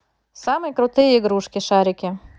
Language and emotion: Russian, positive